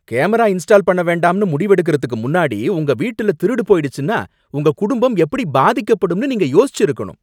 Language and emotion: Tamil, angry